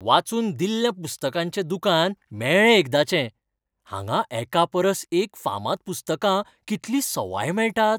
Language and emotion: Goan Konkani, happy